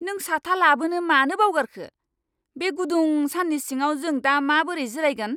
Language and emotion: Bodo, angry